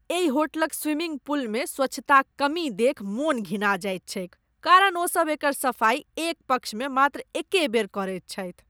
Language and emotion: Maithili, disgusted